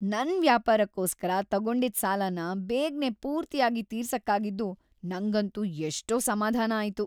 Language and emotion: Kannada, happy